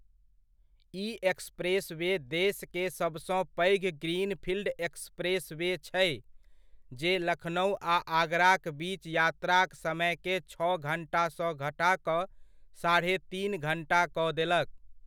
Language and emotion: Maithili, neutral